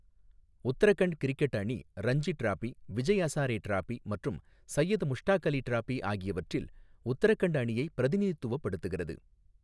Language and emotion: Tamil, neutral